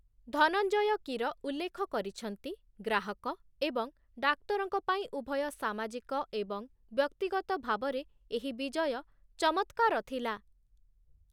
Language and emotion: Odia, neutral